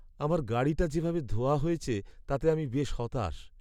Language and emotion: Bengali, sad